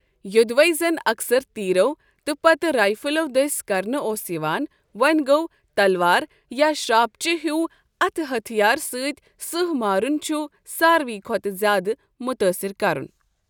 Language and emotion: Kashmiri, neutral